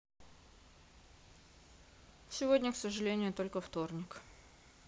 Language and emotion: Russian, sad